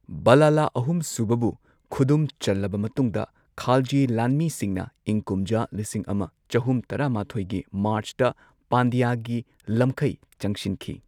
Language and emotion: Manipuri, neutral